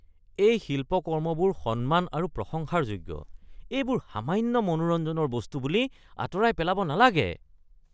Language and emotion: Assamese, disgusted